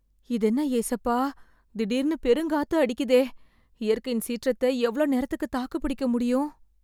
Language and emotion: Tamil, fearful